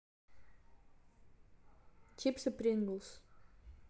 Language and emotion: Russian, neutral